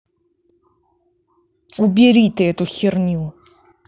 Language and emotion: Russian, angry